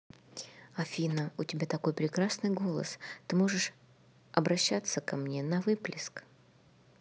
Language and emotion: Russian, neutral